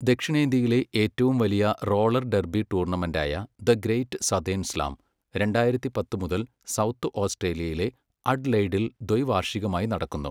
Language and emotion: Malayalam, neutral